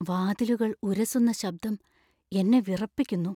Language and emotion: Malayalam, fearful